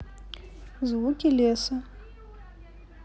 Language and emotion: Russian, neutral